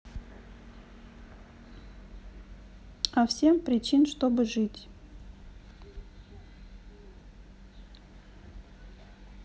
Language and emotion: Russian, neutral